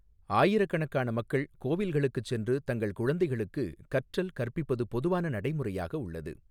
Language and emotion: Tamil, neutral